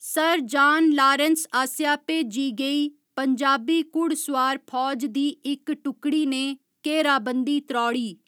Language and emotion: Dogri, neutral